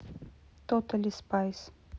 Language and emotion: Russian, neutral